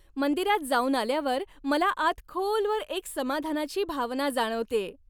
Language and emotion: Marathi, happy